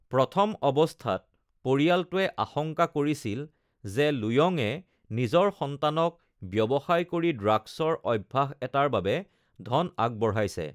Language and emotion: Assamese, neutral